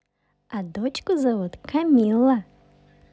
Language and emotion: Russian, positive